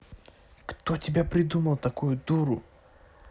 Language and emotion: Russian, angry